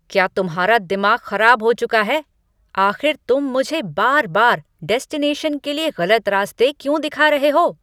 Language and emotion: Hindi, angry